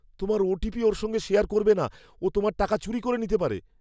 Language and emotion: Bengali, fearful